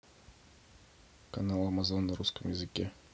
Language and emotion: Russian, neutral